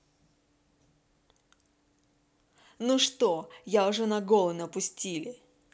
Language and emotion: Russian, angry